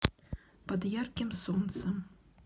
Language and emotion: Russian, neutral